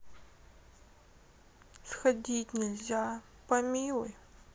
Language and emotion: Russian, sad